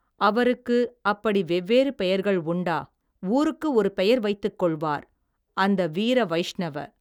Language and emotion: Tamil, neutral